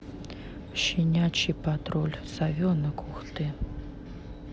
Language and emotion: Russian, neutral